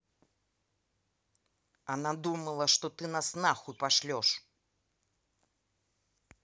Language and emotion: Russian, angry